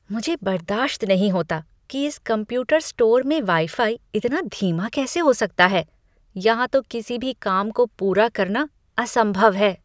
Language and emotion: Hindi, disgusted